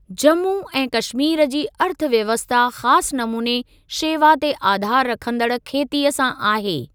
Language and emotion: Sindhi, neutral